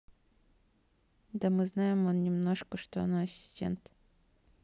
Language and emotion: Russian, neutral